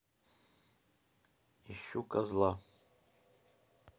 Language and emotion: Russian, neutral